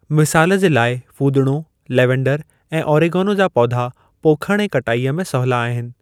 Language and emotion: Sindhi, neutral